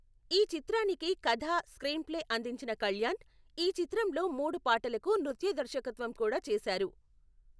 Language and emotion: Telugu, neutral